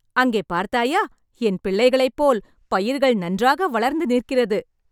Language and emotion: Tamil, happy